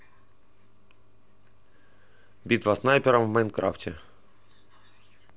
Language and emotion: Russian, neutral